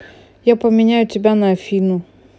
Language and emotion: Russian, neutral